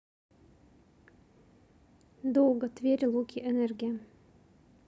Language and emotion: Russian, neutral